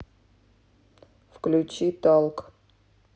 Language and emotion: Russian, neutral